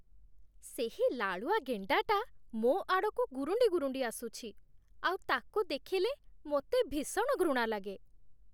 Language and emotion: Odia, disgusted